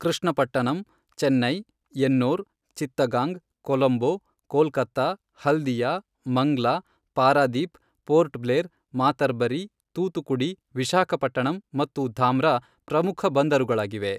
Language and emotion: Kannada, neutral